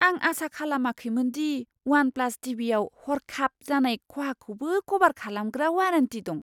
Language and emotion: Bodo, surprised